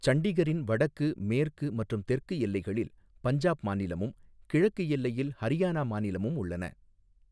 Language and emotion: Tamil, neutral